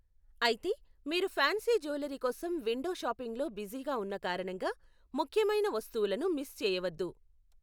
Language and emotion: Telugu, neutral